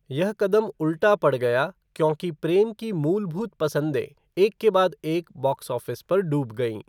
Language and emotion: Hindi, neutral